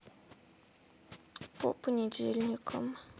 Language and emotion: Russian, sad